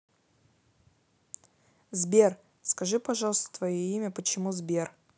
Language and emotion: Russian, neutral